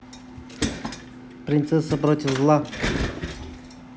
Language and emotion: Russian, neutral